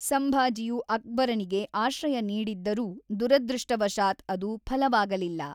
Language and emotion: Kannada, neutral